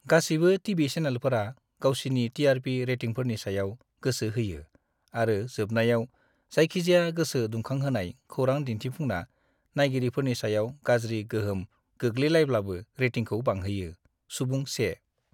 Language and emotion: Bodo, disgusted